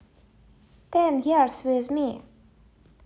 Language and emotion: Russian, neutral